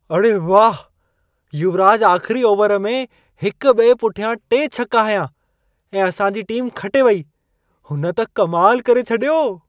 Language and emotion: Sindhi, surprised